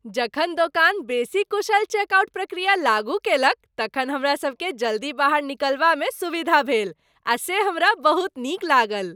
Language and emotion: Maithili, happy